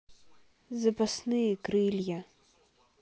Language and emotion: Russian, neutral